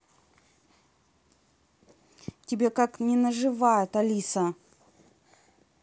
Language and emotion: Russian, angry